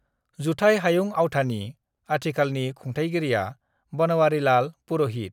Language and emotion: Bodo, neutral